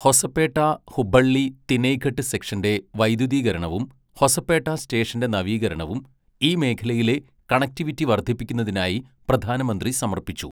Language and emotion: Malayalam, neutral